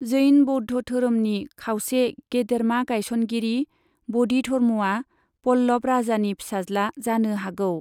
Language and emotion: Bodo, neutral